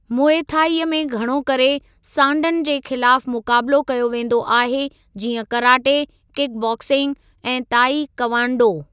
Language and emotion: Sindhi, neutral